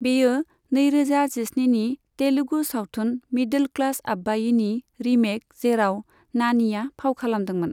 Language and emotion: Bodo, neutral